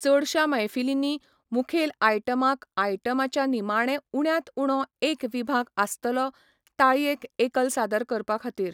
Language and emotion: Goan Konkani, neutral